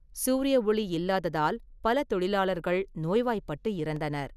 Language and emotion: Tamil, neutral